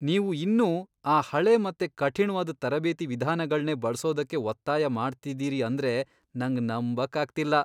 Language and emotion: Kannada, disgusted